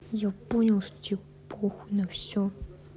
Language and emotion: Russian, angry